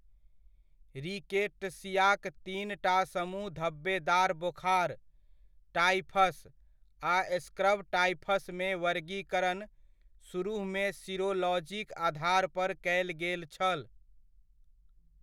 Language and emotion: Maithili, neutral